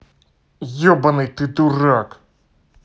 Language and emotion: Russian, angry